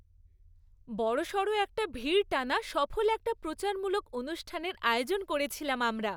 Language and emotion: Bengali, happy